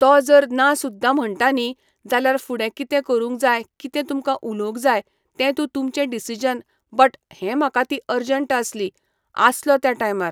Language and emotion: Goan Konkani, neutral